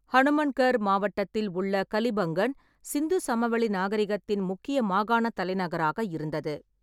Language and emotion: Tamil, neutral